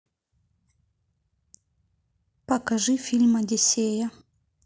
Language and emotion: Russian, neutral